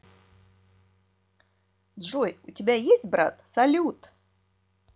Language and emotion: Russian, neutral